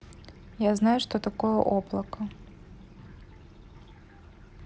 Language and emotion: Russian, neutral